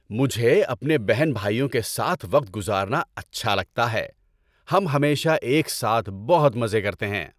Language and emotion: Urdu, happy